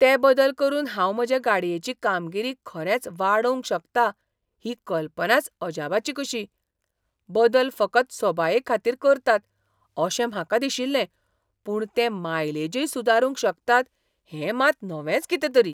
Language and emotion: Goan Konkani, surprised